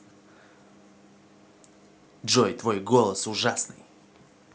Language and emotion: Russian, angry